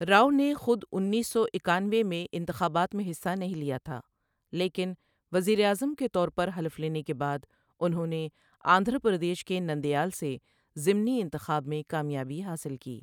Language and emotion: Urdu, neutral